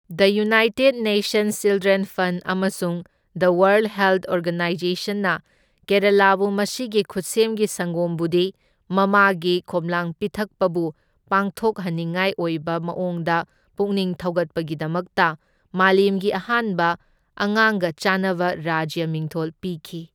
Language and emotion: Manipuri, neutral